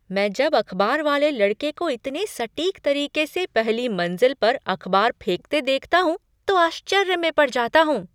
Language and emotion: Hindi, surprised